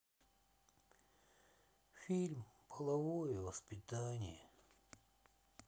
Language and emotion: Russian, sad